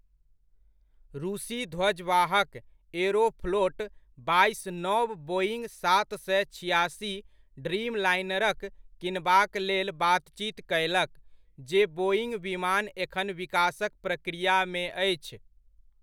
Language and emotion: Maithili, neutral